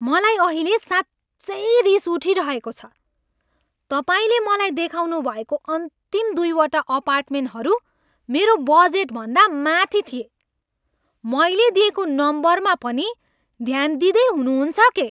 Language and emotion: Nepali, angry